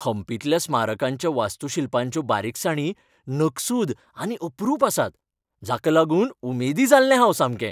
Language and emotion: Goan Konkani, happy